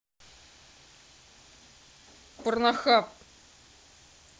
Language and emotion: Russian, angry